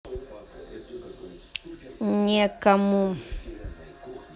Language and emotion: Russian, neutral